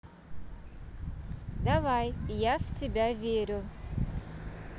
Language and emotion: Russian, positive